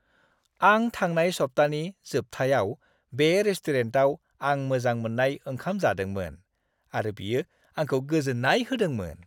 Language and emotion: Bodo, happy